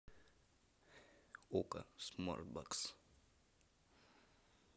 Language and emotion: Russian, neutral